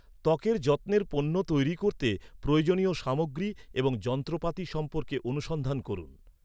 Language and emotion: Bengali, neutral